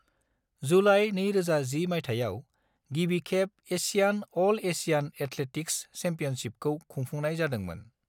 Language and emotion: Bodo, neutral